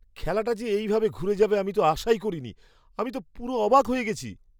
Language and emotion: Bengali, surprised